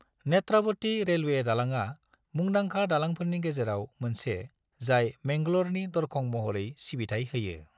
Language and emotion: Bodo, neutral